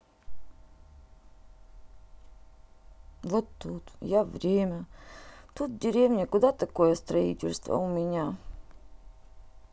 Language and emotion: Russian, sad